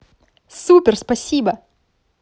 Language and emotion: Russian, positive